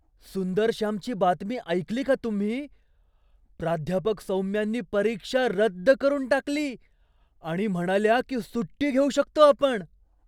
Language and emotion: Marathi, surprised